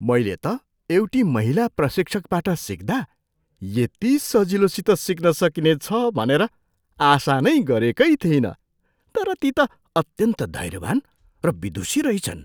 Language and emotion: Nepali, surprised